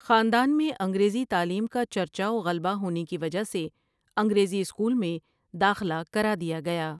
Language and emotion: Urdu, neutral